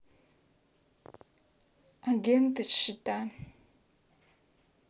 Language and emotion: Russian, neutral